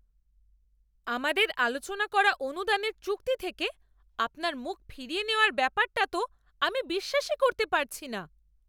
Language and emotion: Bengali, angry